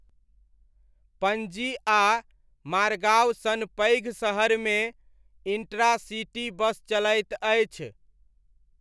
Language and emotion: Maithili, neutral